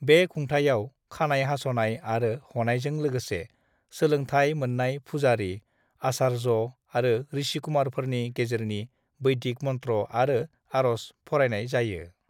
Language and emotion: Bodo, neutral